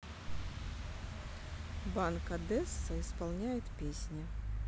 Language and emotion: Russian, neutral